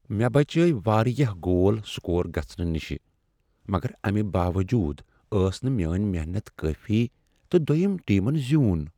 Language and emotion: Kashmiri, sad